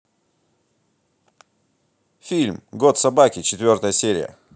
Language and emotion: Russian, positive